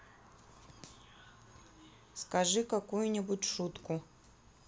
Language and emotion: Russian, neutral